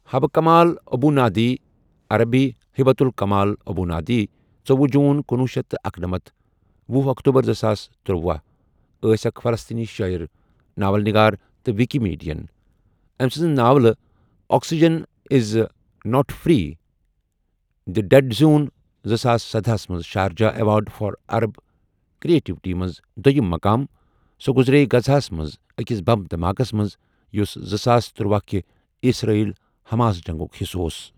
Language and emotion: Kashmiri, neutral